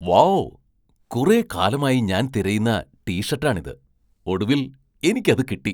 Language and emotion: Malayalam, surprised